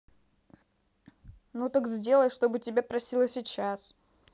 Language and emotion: Russian, angry